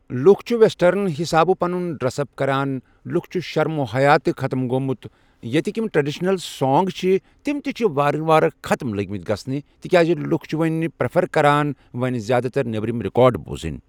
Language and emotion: Kashmiri, neutral